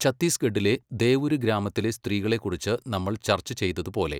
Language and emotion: Malayalam, neutral